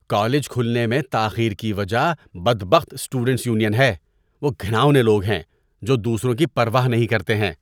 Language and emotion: Urdu, disgusted